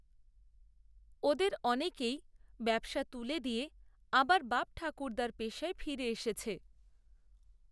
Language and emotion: Bengali, neutral